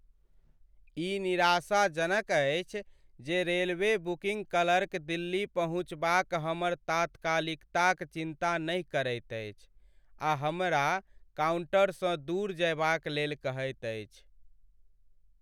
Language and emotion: Maithili, sad